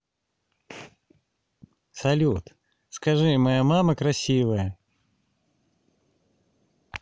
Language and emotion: Russian, positive